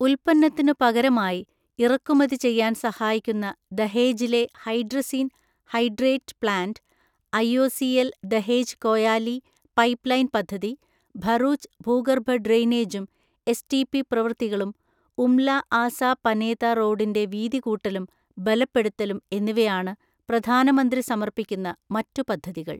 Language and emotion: Malayalam, neutral